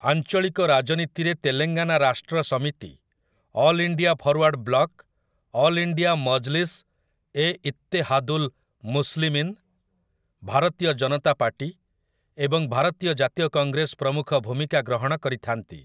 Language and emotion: Odia, neutral